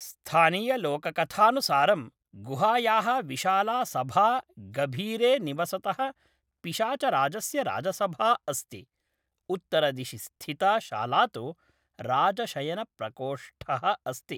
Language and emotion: Sanskrit, neutral